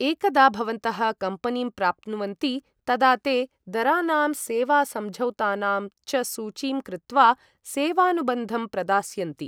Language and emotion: Sanskrit, neutral